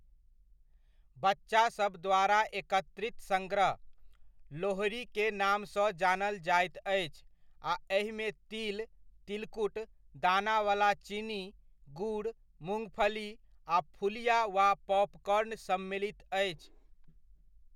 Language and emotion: Maithili, neutral